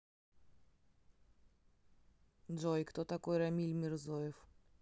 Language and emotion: Russian, neutral